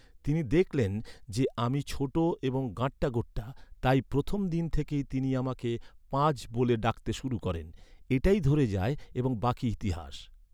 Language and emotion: Bengali, neutral